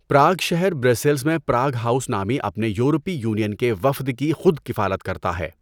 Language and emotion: Urdu, neutral